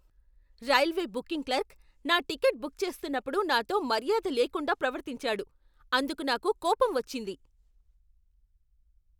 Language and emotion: Telugu, angry